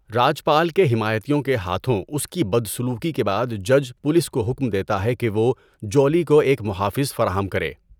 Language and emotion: Urdu, neutral